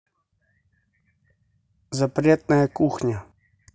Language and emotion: Russian, neutral